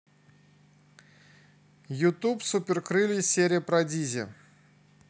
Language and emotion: Russian, neutral